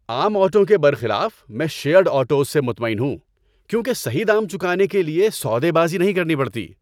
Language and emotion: Urdu, happy